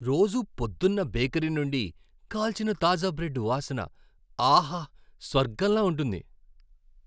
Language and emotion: Telugu, happy